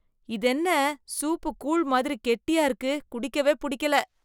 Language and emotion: Tamil, disgusted